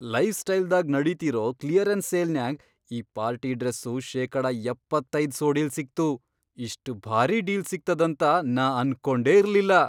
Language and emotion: Kannada, surprised